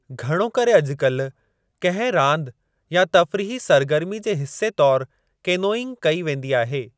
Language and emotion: Sindhi, neutral